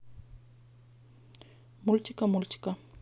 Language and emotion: Russian, neutral